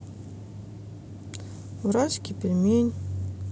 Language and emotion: Russian, sad